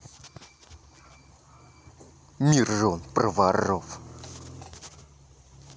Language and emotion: Russian, angry